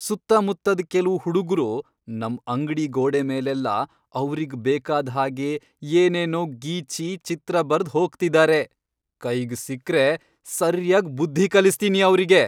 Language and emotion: Kannada, angry